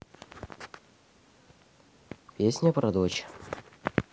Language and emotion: Russian, neutral